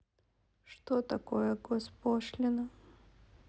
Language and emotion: Russian, sad